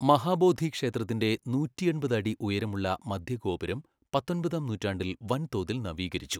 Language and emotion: Malayalam, neutral